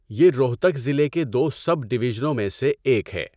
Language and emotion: Urdu, neutral